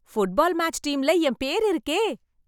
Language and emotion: Tamil, happy